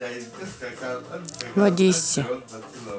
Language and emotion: Russian, neutral